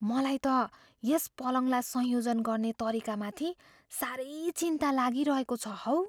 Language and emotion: Nepali, fearful